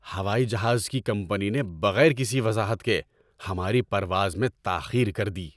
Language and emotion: Urdu, angry